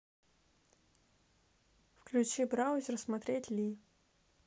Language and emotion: Russian, neutral